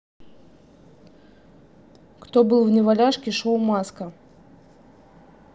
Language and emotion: Russian, neutral